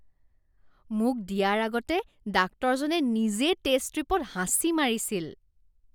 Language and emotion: Assamese, disgusted